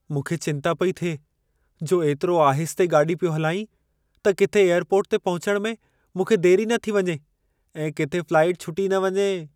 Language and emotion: Sindhi, fearful